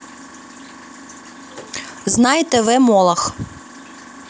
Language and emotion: Russian, neutral